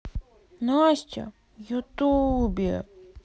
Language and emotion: Russian, sad